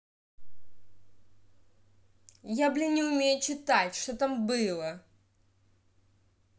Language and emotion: Russian, angry